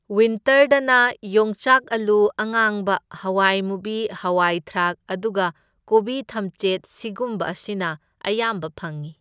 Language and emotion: Manipuri, neutral